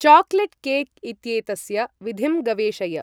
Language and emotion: Sanskrit, neutral